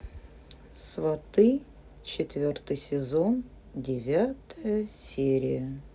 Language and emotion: Russian, neutral